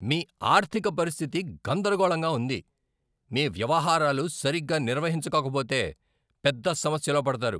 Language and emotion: Telugu, angry